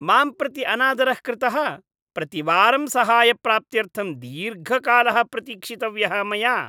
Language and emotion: Sanskrit, disgusted